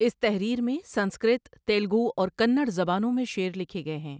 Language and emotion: Urdu, neutral